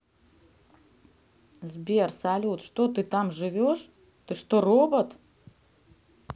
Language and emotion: Russian, neutral